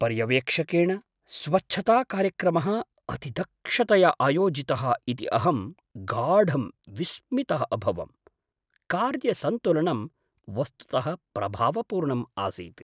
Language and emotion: Sanskrit, surprised